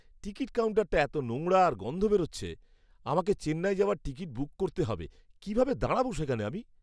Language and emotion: Bengali, disgusted